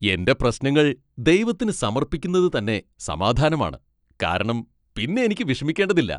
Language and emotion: Malayalam, happy